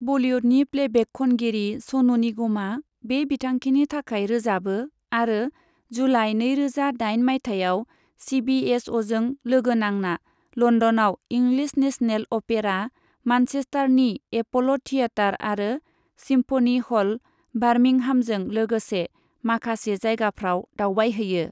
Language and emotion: Bodo, neutral